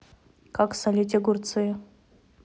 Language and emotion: Russian, neutral